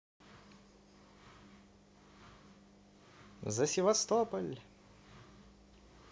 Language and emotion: Russian, positive